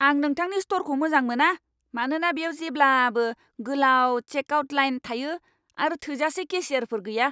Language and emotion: Bodo, angry